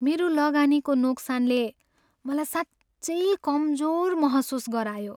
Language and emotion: Nepali, sad